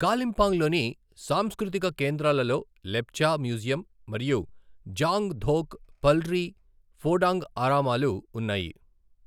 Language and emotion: Telugu, neutral